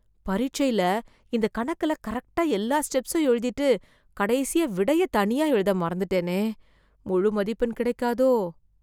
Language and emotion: Tamil, fearful